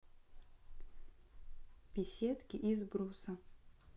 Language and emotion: Russian, neutral